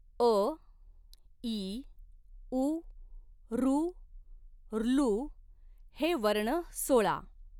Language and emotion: Marathi, neutral